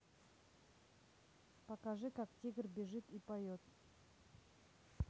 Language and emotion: Russian, neutral